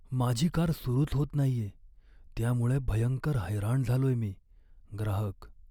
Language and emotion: Marathi, sad